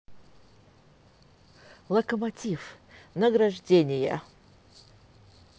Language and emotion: Russian, positive